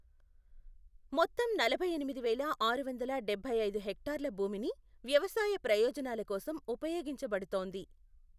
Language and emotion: Telugu, neutral